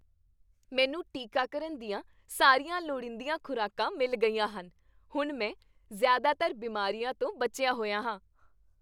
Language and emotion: Punjabi, happy